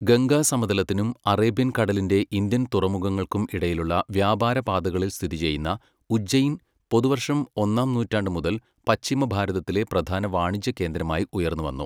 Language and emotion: Malayalam, neutral